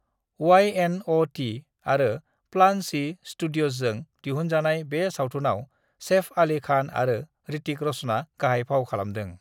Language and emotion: Bodo, neutral